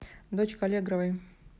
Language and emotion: Russian, neutral